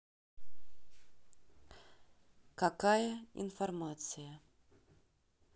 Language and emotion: Russian, neutral